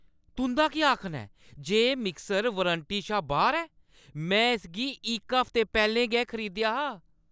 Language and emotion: Dogri, angry